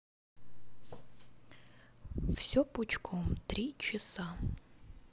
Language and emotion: Russian, neutral